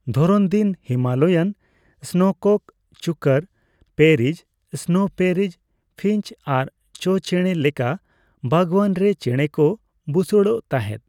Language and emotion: Santali, neutral